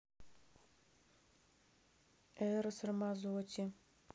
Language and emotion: Russian, neutral